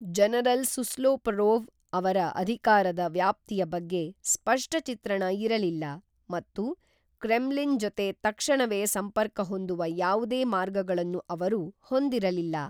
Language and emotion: Kannada, neutral